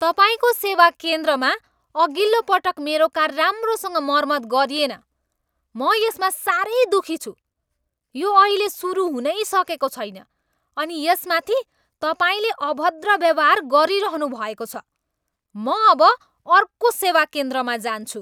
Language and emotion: Nepali, angry